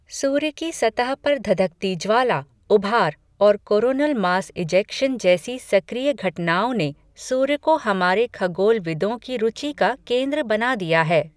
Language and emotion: Hindi, neutral